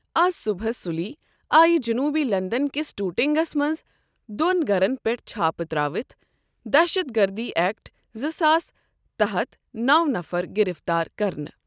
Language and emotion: Kashmiri, neutral